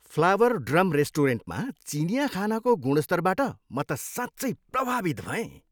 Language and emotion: Nepali, happy